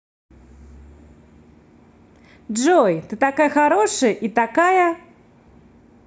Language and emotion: Russian, positive